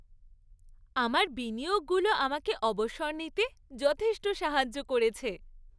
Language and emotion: Bengali, happy